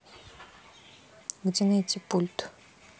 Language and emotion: Russian, neutral